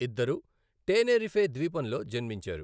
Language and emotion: Telugu, neutral